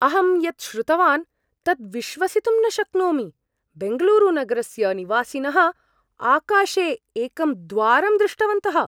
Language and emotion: Sanskrit, surprised